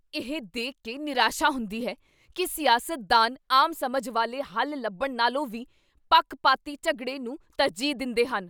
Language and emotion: Punjabi, angry